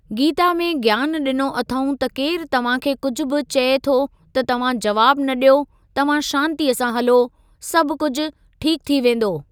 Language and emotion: Sindhi, neutral